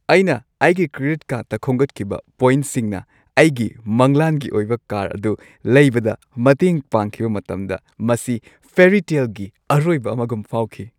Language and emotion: Manipuri, happy